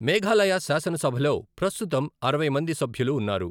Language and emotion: Telugu, neutral